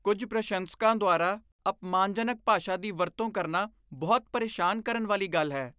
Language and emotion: Punjabi, disgusted